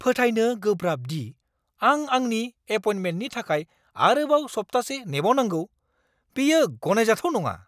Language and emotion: Bodo, angry